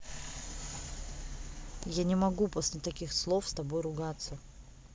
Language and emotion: Russian, angry